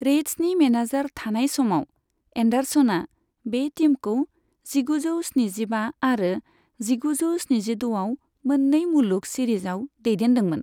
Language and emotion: Bodo, neutral